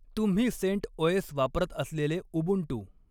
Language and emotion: Marathi, neutral